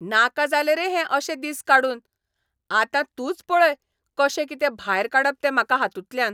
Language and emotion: Goan Konkani, angry